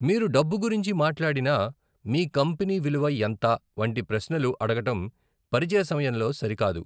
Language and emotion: Telugu, neutral